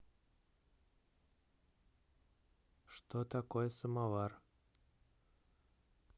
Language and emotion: Russian, neutral